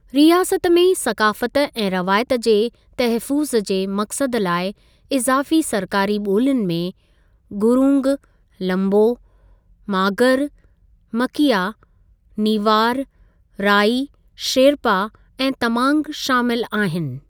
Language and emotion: Sindhi, neutral